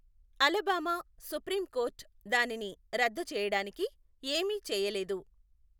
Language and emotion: Telugu, neutral